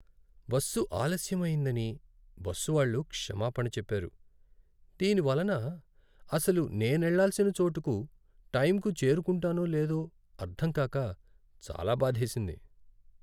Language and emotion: Telugu, sad